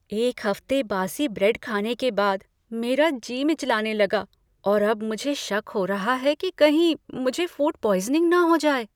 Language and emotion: Hindi, fearful